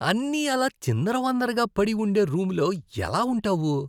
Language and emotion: Telugu, disgusted